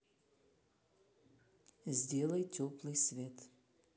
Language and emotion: Russian, neutral